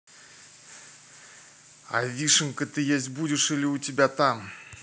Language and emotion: Russian, neutral